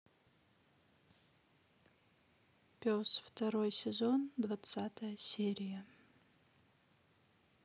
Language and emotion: Russian, neutral